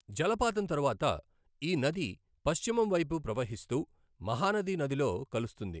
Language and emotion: Telugu, neutral